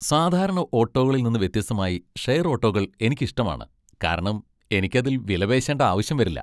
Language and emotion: Malayalam, happy